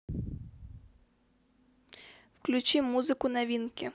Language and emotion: Russian, neutral